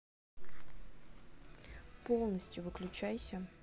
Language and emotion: Russian, neutral